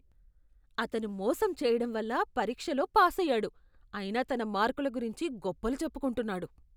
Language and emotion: Telugu, disgusted